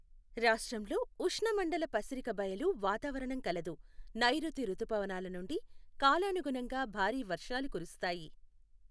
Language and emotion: Telugu, neutral